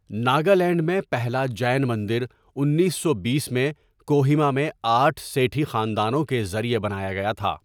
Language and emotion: Urdu, neutral